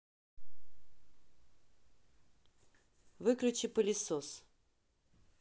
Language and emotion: Russian, neutral